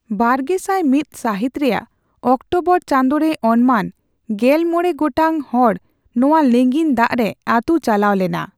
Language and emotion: Santali, neutral